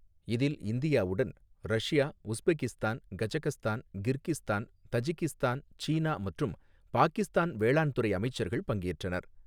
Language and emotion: Tamil, neutral